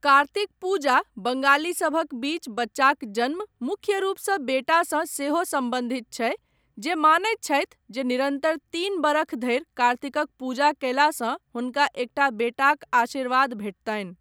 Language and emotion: Maithili, neutral